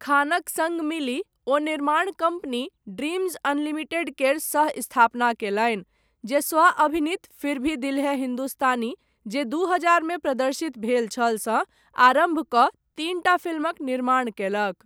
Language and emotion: Maithili, neutral